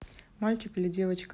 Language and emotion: Russian, neutral